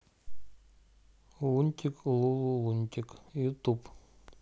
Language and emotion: Russian, neutral